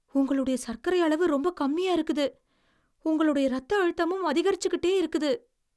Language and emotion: Tamil, fearful